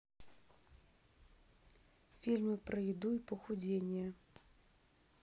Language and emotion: Russian, neutral